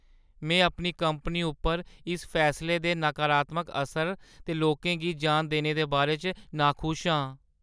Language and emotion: Dogri, sad